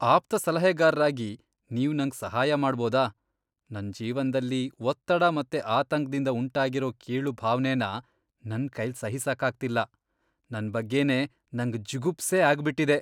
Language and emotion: Kannada, disgusted